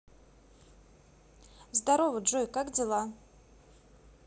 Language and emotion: Russian, positive